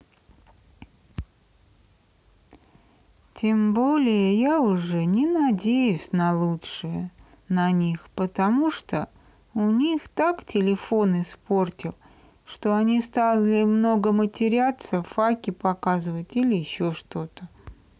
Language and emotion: Russian, sad